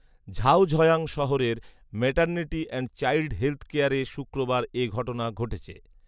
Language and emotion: Bengali, neutral